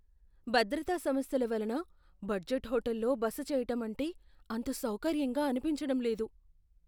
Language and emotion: Telugu, fearful